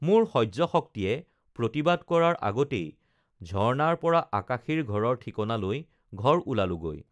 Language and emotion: Assamese, neutral